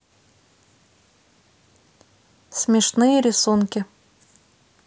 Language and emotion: Russian, neutral